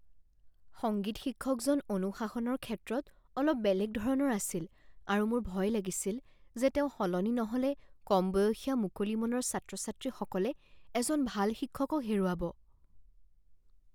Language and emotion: Assamese, fearful